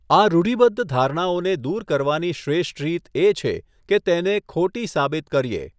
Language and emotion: Gujarati, neutral